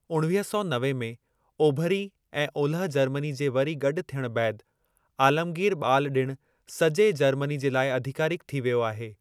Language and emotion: Sindhi, neutral